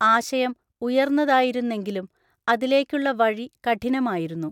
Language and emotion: Malayalam, neutral